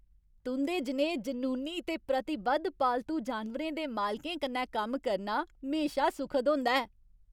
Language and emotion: Dogri, happy